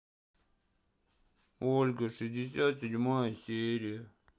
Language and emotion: Russian, sad